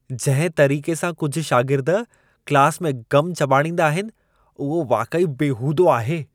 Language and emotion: Sindhi, disgusted